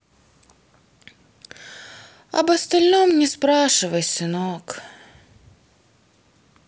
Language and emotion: Russian, sad